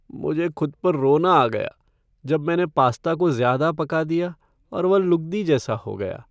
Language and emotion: Hindi, sad